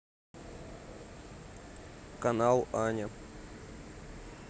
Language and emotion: Russian, neutral